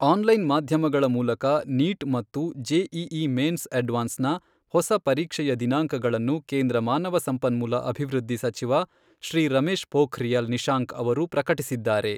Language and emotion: Kannada, neutral